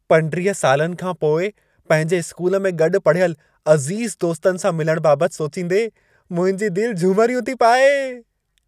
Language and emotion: Sindhi, happy